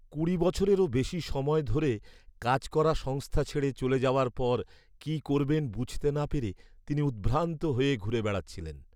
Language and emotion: Bengali, sad